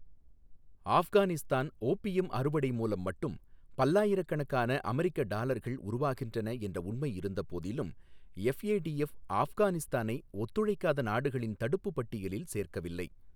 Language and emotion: Tamil, neutral